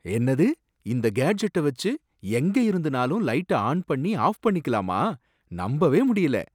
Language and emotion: Tamil, surprised